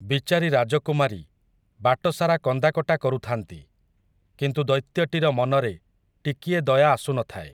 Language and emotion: Odia, neutral